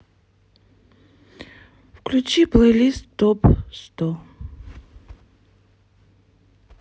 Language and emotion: Russian, sad